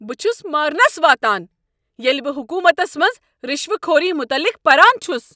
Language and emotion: Kashmiri, angry